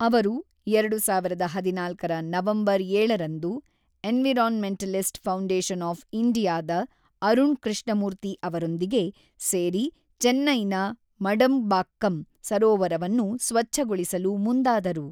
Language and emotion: Kannada, neutral